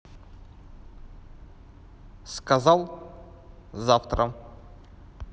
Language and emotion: Russian, neutral